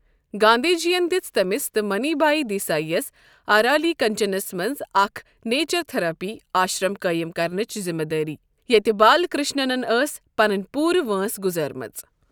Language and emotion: Kashmiri, neutral